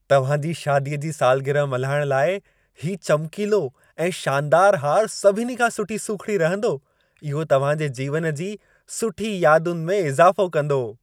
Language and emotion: Sindhi, happy